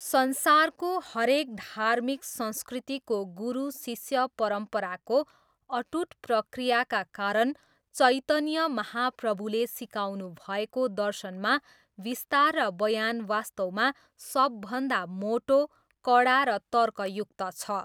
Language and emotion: Nepali, neutral